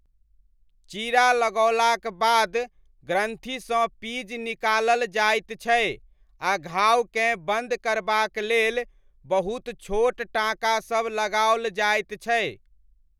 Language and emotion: Maithili, neutral